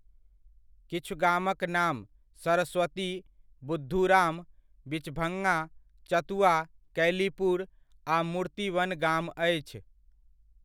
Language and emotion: Maithili, neutral